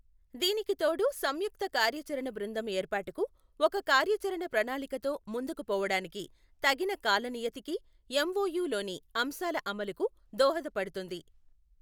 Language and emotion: Telugu, neutral